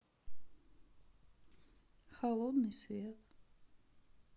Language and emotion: Russian, sad